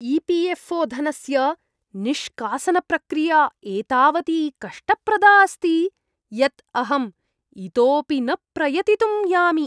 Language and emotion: Sanskrit, disgusted